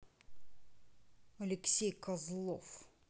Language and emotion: Russian, angry